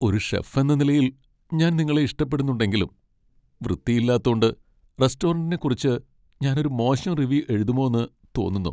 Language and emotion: Malayalam, sad